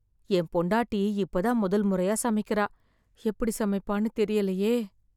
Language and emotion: Tamil, fearful